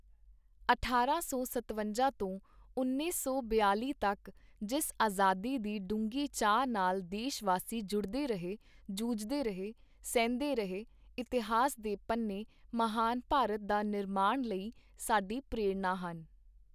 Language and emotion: Punjabi, neutral